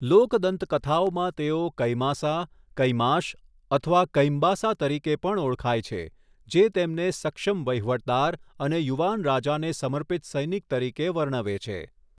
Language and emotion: Gujarati, neutral